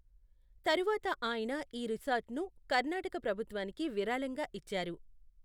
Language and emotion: Telugu, neutral